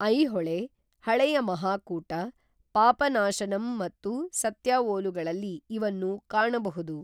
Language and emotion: Kannada, neutral